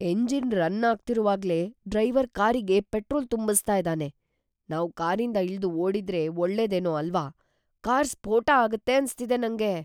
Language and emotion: Kannada, fearful